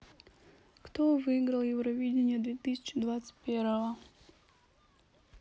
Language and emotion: Russian, neutral